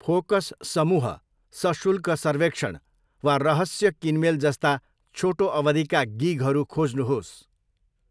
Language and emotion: Nepali, neutral